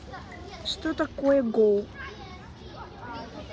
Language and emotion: Russian, neutral